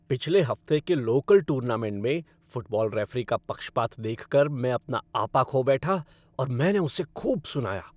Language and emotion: Hindi, angry